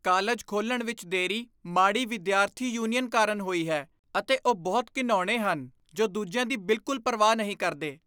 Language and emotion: Punjabi, disgusted